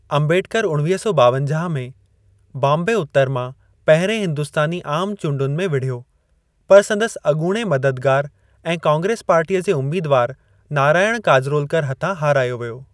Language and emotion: Sindhi, neutral